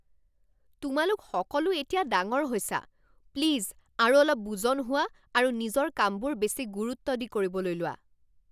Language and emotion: Assamese, angry